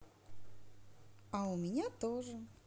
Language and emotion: Russian, positive